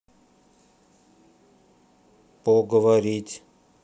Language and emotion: Russian, neutral